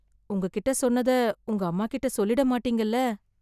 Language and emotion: Tamil, fearful